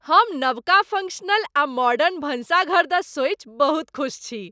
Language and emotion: Maithili, happy